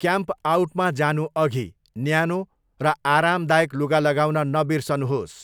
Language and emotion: Nepali, neutral